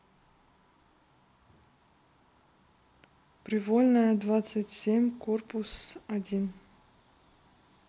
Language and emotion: Russian, neutral